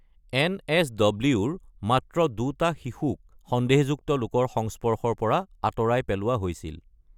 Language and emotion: Assamese, neutral